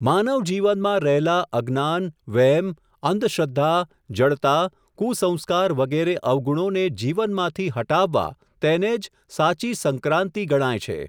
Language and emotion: Gujarati, neutral